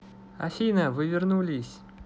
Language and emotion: Russian, positive